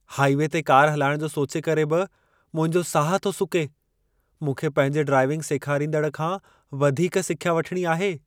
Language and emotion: Sindhi, fearful